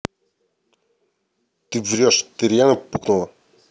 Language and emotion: Russian, angry